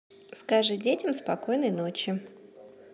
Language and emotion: Russian, neutral